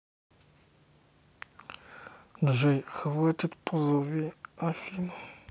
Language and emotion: Russian, neutral